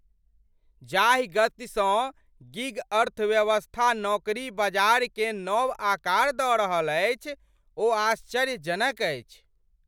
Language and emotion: Maithili, surprised